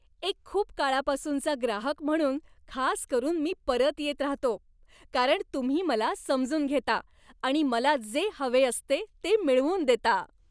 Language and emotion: Marathi, happy